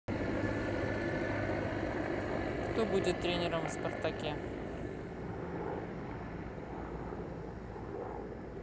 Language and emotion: Russian, neutral